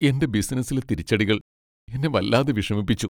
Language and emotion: Malayalam, sad